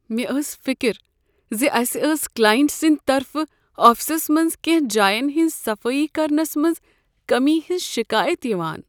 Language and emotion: Kashmiri, sad